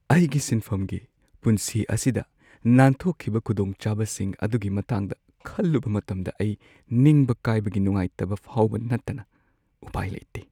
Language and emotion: Manipuri, sad